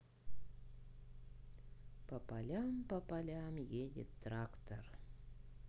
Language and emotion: Russian, neutral